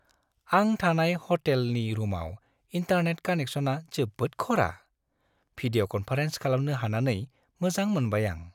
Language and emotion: Bodo, happy